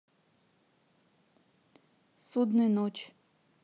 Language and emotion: Russian, neutral